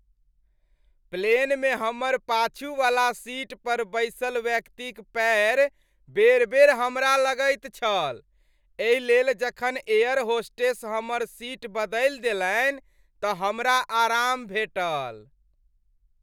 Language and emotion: Maithili, happy